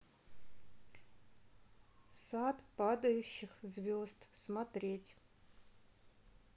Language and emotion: Russian, neutral